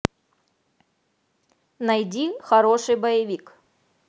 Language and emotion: Russian, positive